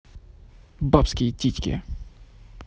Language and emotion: Russian, angry